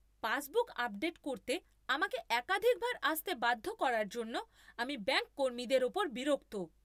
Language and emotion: Bengali, angry